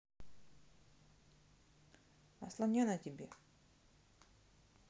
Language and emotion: Russian, neutral